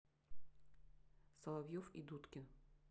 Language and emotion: Russian, neutral